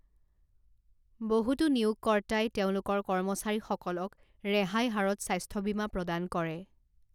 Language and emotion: Assamese, neutral